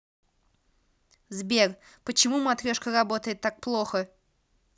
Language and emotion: Russian, neutral